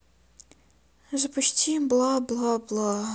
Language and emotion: Russian, sad